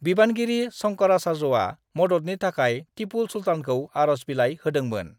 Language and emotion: Bodo, neutral